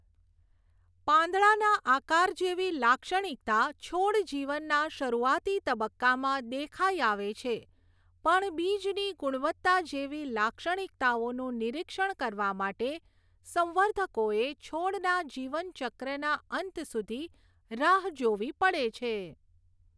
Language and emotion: Gujarati, neutral